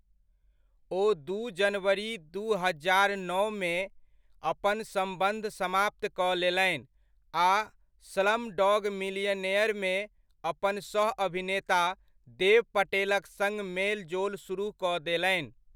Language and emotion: Maithili, neutral